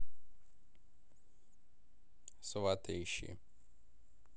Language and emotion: Russian, neutral